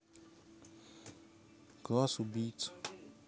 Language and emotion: Russian, neutral